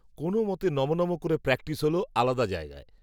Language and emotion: Bengali, neutral